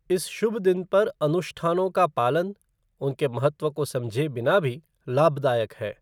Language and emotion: Hindi, neutral